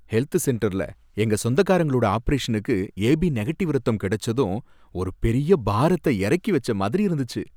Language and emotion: Tamil, happy